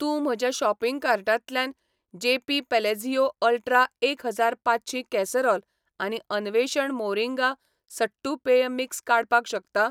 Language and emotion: Goan Konkani, neutral